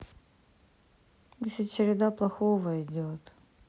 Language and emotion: Russian, sad